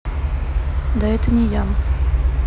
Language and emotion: Russian, neutral